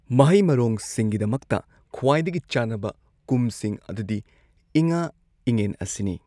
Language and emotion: Manipuri, neutral